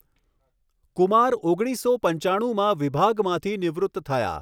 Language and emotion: Gujarati, neutral